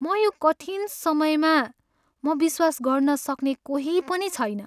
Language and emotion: Nepali, sad